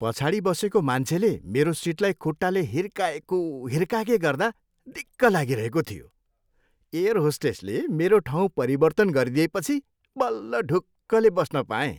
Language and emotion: Nepali, happy